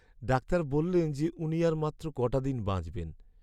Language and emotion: Bengali, sad